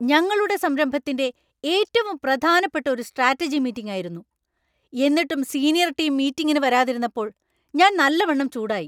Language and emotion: Malayalam, angry